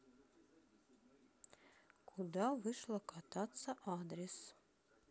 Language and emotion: Russian, neutral